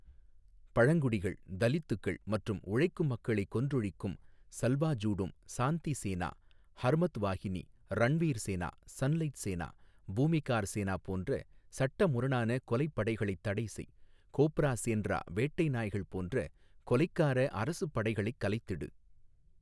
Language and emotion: Tamil, neutral